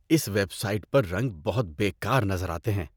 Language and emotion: Urdu, disgusted